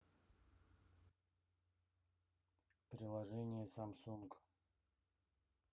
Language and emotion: Russian, neutral